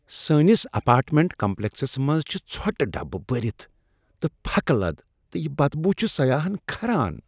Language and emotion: Kashmiri, disgusted